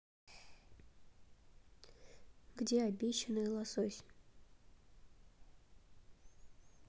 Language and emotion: Russian, neutral